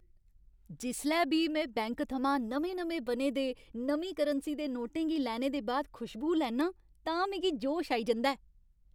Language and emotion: Dogri, happy